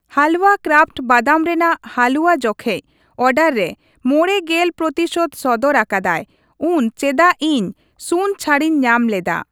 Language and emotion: Santali, neutral